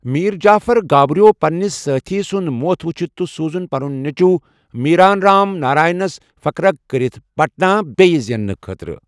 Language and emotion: Kashmiri, neutral